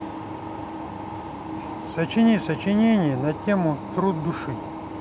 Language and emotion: Russian, neutral